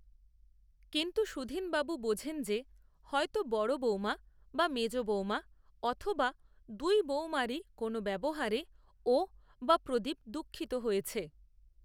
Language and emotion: Bengali, neutral